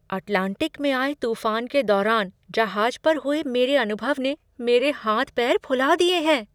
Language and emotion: Hindi, surprised